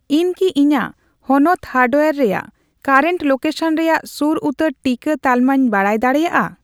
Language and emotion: Santali, neutral